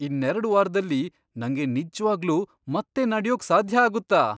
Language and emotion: Kannada, surprised